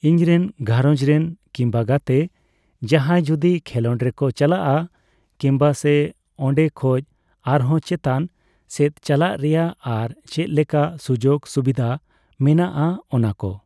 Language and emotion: Santali, neutral